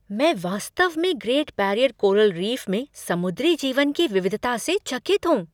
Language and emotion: Hindi, surprised